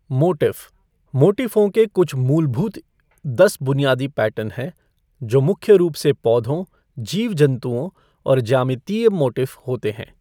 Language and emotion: Hindi, neutral